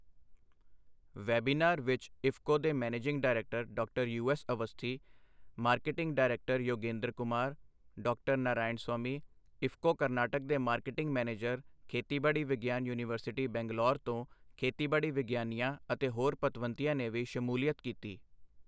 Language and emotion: Punjabi, neutral